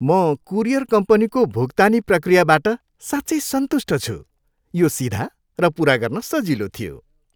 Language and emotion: Nepali, happy